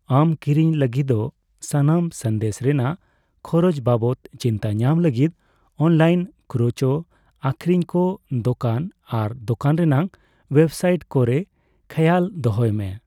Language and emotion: Santali, neutral